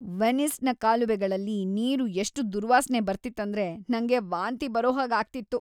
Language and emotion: Kannada, disgusted